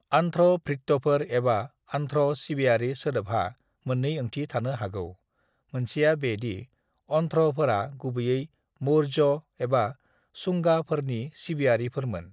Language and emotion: Bodo, neutral